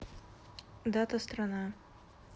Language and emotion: Russian, neutral